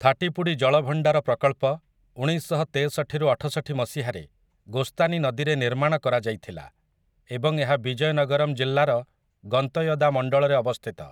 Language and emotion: Odia, neutral